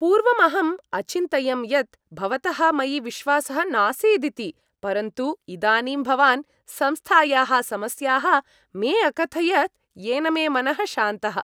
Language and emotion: Sanskrit, happy